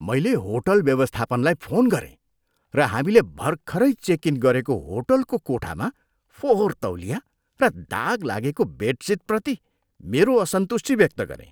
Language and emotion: Nepali, disgusted